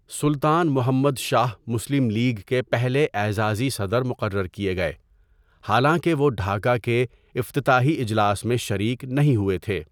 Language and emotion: Urdu, neutral